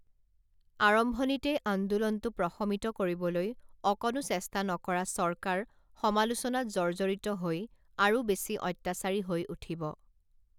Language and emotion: Assamese, neutral